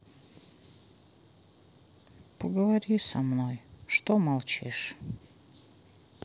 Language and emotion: Russian, sad